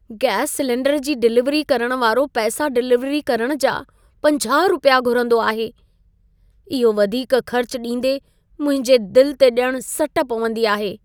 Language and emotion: Sindhi, sad